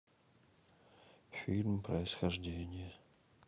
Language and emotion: Russian, sad